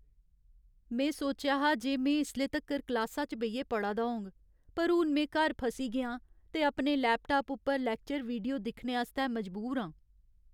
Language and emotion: Dogri, sad